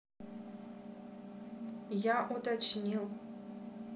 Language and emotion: Russian, neutral